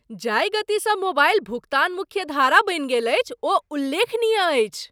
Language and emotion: Maithili, surprised